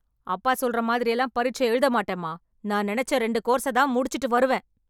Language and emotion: Tamil, angry